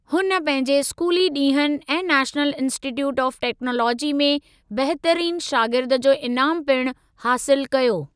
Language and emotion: Sindhi, neutral